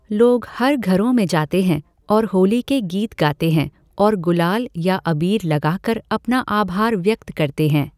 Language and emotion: Hindi, neutral